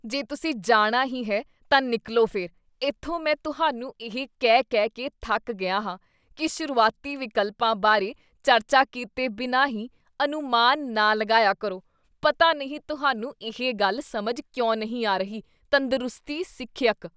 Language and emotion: Punjabi, disgusted